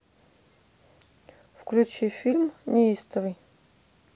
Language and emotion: Russian, neutral